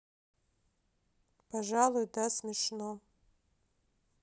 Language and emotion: Russian, sad